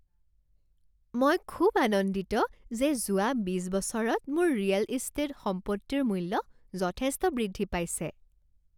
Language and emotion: Assamese, happy